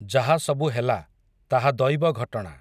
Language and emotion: Odia, neutral